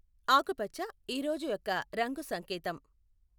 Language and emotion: Telugu, neutral